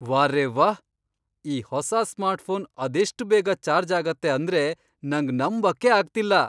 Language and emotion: Kannada, surprised